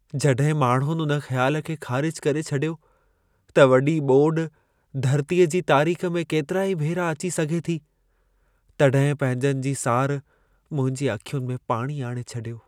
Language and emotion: Sindhi, sad